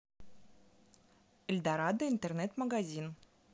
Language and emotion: Russian, neutral